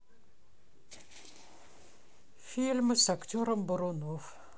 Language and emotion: Russian, neutral